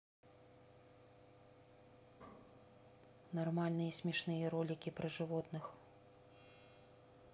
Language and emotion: Russian, neutral